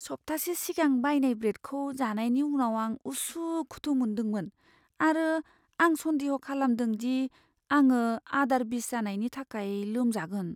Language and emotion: Bodo, fearful